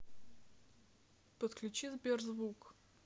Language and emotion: Russian, neutral